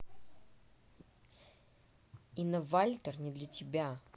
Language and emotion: Russian, angry